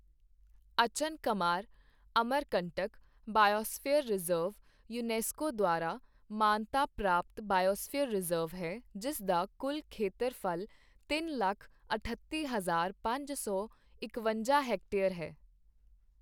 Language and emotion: Punjabi, neutral